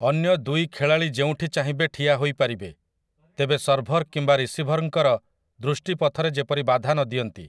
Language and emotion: Odia, neutral